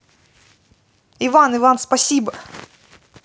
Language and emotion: Russian, positive